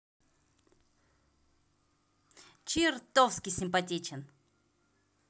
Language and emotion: Russian, positive